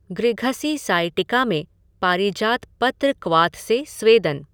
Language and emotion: Hindi, neutral